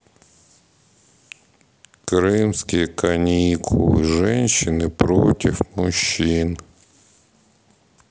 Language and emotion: Russian, sad